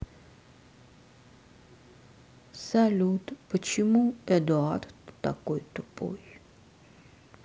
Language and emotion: Russian, sad